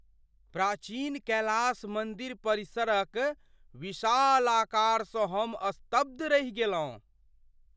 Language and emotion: Maithili, surprised